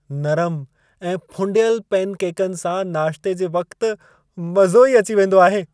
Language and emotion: Sindhi, happy